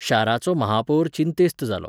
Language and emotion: Goan Konkani, neutral